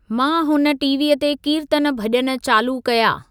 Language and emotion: Sindhi, neutral